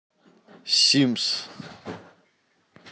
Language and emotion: Russian, neutral